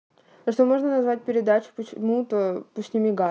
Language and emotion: Russian, neutral